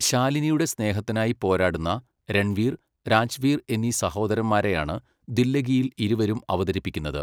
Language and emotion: Malayalam, neutral